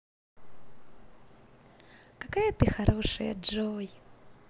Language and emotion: Russian, positive